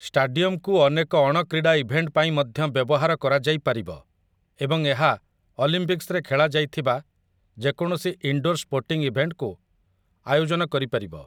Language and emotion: Odia, neutral